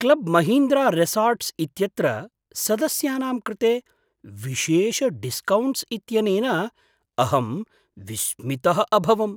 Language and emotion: Sanskrit, surprised